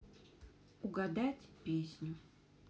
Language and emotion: Russian, neutral